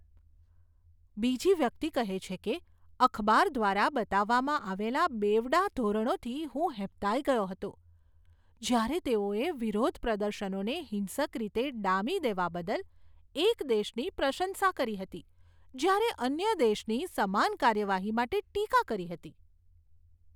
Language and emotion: Gujarati, disgusted